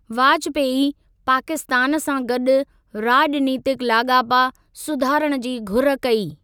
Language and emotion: Sindhi, neutral